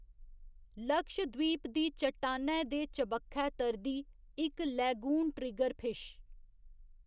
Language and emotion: Dogri, neutral